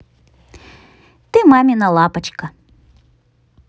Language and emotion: Russian, positive